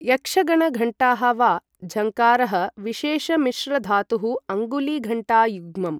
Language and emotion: Sanskrit, neutral